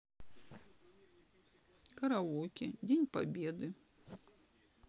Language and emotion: Russian, sad